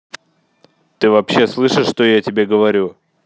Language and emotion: Russian, angry